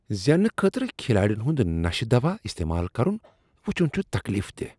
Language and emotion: Kashmiri, disgusted